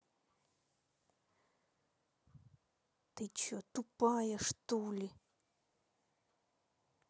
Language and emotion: Russian, angry